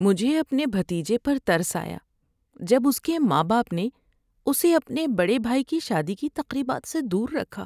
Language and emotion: Urdu, sad